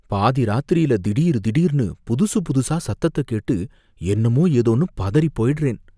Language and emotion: Tamil, fearful